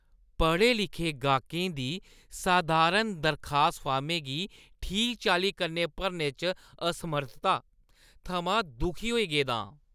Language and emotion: Dogri, disgusted